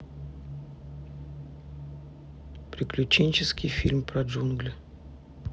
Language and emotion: Russian, neutral